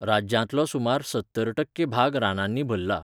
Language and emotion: Goan Konkani, neutral